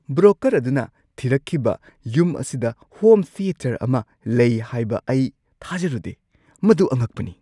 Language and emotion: Manipuri, surprised